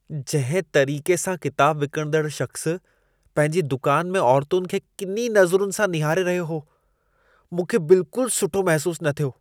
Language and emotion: Sindhi, disgusted